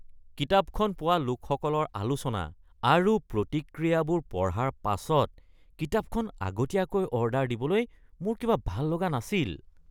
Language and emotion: Assamese, disgusted